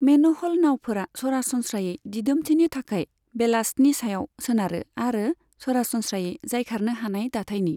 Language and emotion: Bodo, neutral